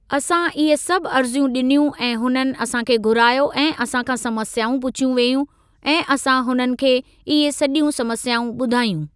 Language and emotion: Sindhi, neutral